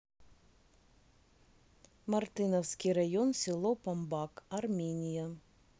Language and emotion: Russian, neutral